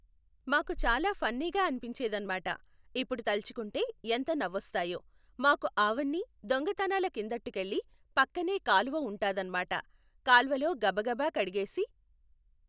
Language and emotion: Telugu, neutral